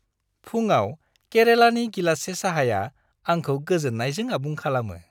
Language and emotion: Bodo, happy